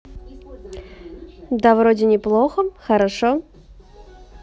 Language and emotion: Russian, positive